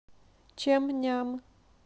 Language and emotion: Russian, neutral